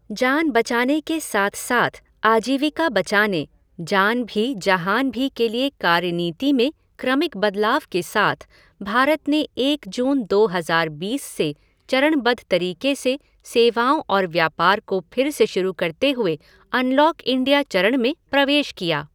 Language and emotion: Hindi, neutral